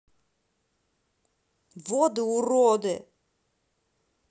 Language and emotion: Russian, angry